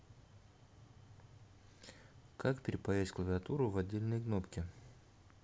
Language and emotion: Russian, neutral